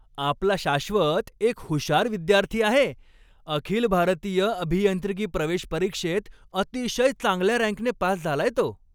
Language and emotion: Marathi, happy